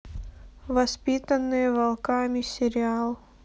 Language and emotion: Russian, neutral